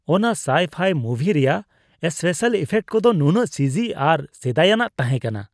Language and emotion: Santali, disgusted